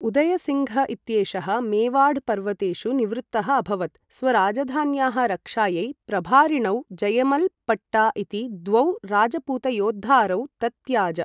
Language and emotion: Sanskrit, neutral